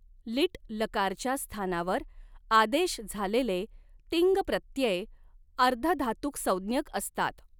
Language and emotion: Marathi, neutral